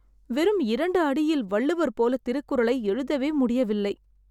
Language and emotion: Tamil, sad